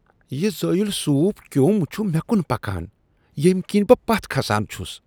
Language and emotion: Kashmiri, disgusted